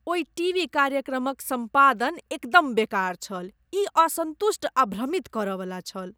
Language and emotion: Maithili, disgusted